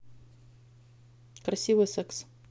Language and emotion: Russian, neutral